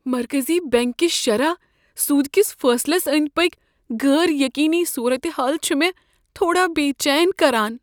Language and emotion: Kashmiri, fearful